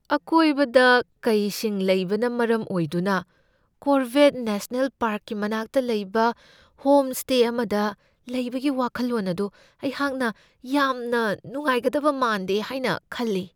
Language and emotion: Manipuri, fearful